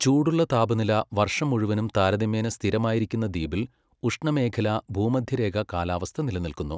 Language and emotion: Malayalam, neutral